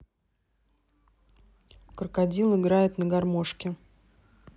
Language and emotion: Russian, neutral